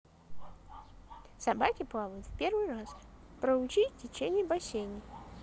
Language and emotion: Russian, positive